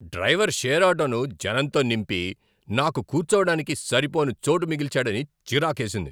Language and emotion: Telugu, angry